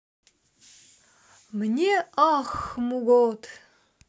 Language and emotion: Russian, positive